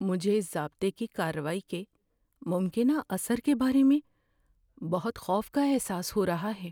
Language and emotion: Urdu, fearful